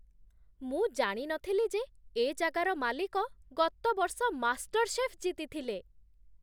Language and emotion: Odia, surprised